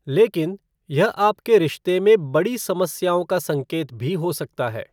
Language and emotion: Hindi, neutral